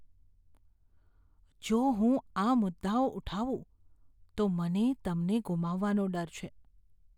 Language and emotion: Gujarati, fearful